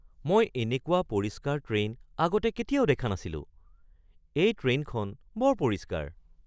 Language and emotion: Assamese, surprised